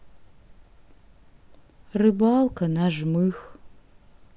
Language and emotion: Russian, neutral